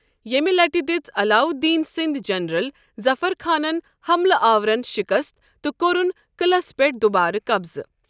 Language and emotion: Kashmiri, neutral